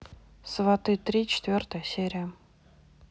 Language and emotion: Russian, neutral